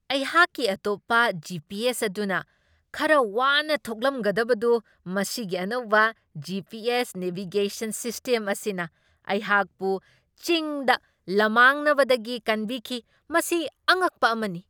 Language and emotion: Manipuri, surprised